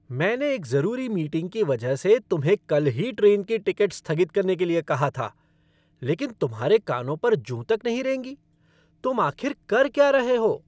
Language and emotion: Hindi, angry